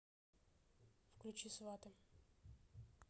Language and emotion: Russian, neutral